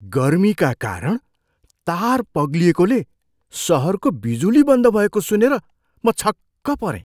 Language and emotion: Nepali, surprised